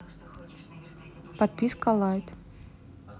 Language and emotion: Russian, neutral